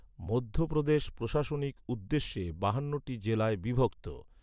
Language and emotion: Bengali, neutral